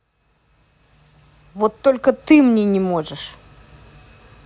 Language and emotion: Russian, angry